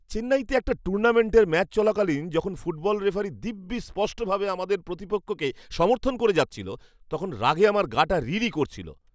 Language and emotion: Bengali, angry